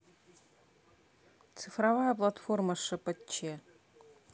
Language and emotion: Russian, neutral